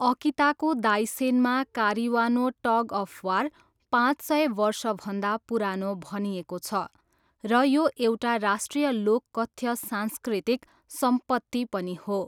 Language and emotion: Nepali, neutral